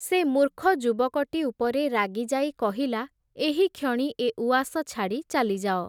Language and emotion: Odia, neutral